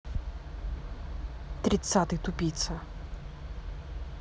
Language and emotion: Russian, angry